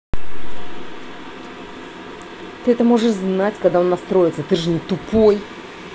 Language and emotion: Russian, angry